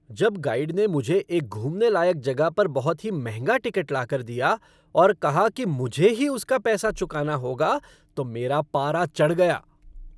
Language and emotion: Hindi, angry